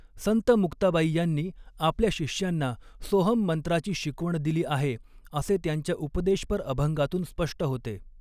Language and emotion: Marathi, neutral